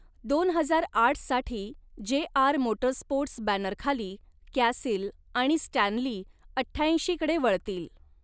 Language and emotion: Marathi, neutral